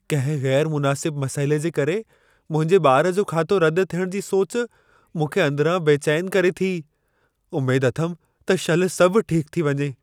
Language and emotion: Sindhi, fearful